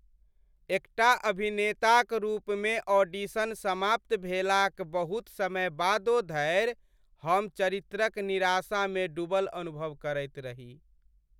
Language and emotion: Maithili, sad